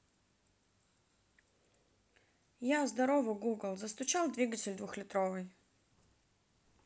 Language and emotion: Russian, neutral